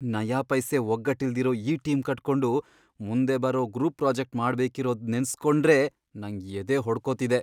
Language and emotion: Kannada, fearful